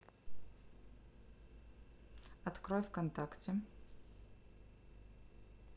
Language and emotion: Russian, neutral